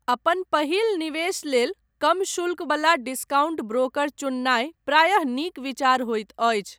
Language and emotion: Maithili, neutral